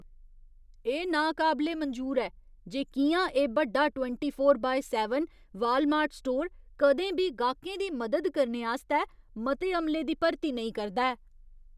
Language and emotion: Dogri, disgusted